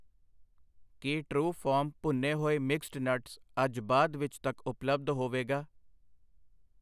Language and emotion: Punjabi, neutral